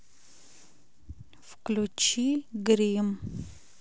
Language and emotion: Russian, neutral